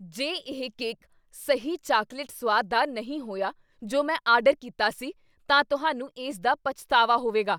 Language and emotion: Punjabi, angry